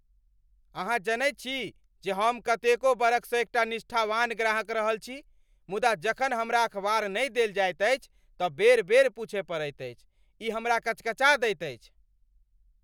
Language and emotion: Maithili, angry